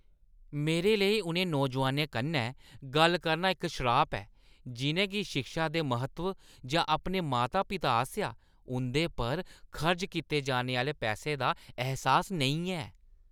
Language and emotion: Dogri, disgusted